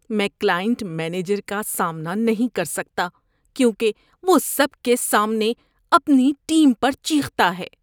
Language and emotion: Urdu, disgusted